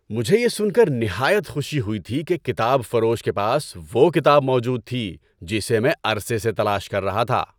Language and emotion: Urdu, happy